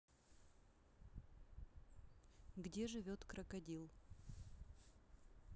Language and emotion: Russian, neutral